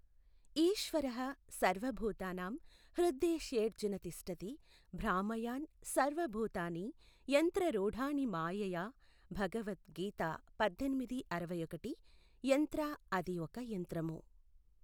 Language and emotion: Telugu, neutral